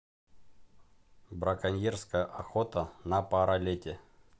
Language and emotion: Russian, neutral